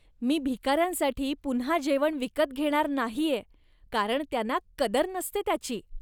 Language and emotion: Marathi, disgusted